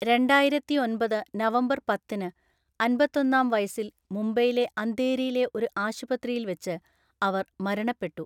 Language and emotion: Malayalam, neutral